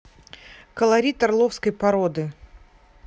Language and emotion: Russian, neutral